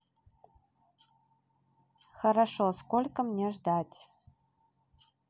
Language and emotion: Russian, neutral